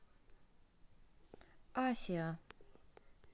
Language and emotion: Russian, neutral